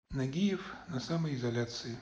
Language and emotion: Russian, neutral